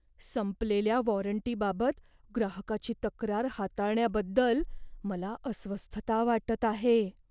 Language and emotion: Marathi, fearful